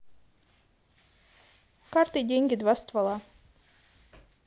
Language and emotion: Russian, positive